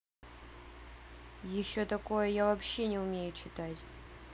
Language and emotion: Russian, angry